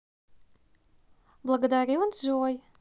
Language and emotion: Russian, positive